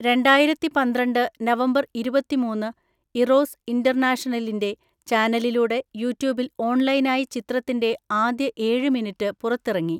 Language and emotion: Malayalam, neutral